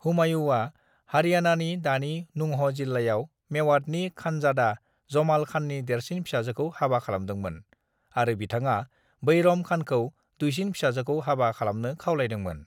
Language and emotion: Bodo, neutral